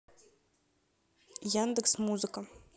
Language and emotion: Russian, neutral